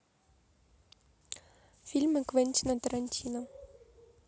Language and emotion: Russian, neutral